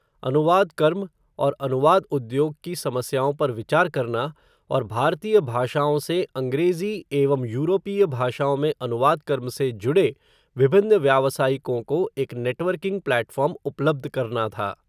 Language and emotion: Hindi, neutral